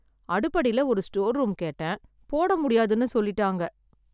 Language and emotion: Tamil, sad